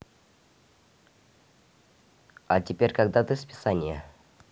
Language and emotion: Russian, neutral